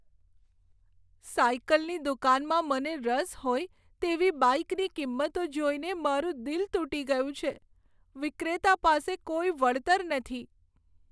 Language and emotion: Gujarati, sad